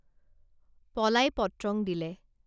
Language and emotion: Assamese, neutral